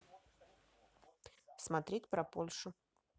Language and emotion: Russian, neutral